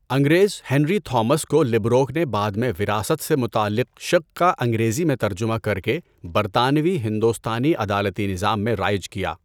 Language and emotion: Urdu, neutral